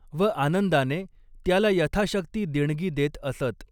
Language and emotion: Marathi, neutral